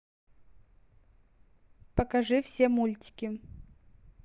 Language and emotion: Russian, neutral